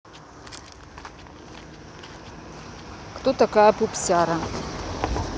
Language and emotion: Russian, neutral